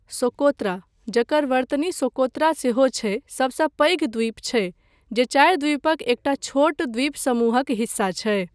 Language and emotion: Maithili, neutral